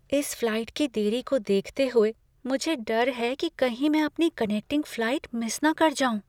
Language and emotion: Hindi, fearful